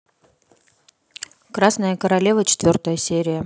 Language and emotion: Russian, neutral